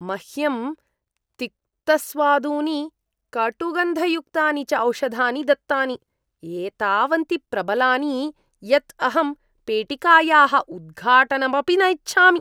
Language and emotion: Sanskrit, disgusted